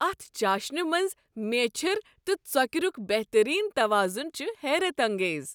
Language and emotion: Kashmiri, happy